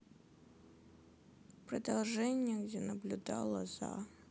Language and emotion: Russian, sad